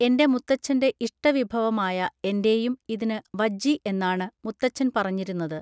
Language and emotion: Malayalam, neutral